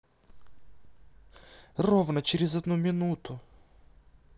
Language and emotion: Russian, angry